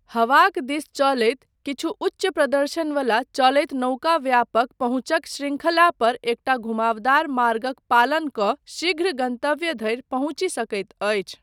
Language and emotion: Maithili, neutral